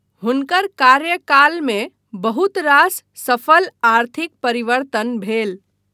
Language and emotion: Maithili, neutral